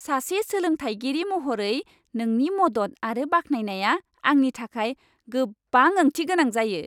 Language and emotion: Bodo, happy